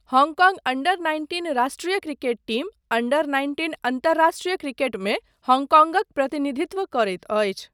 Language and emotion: Maithili, neutral